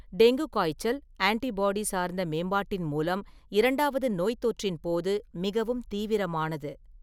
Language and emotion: Tamil, neutral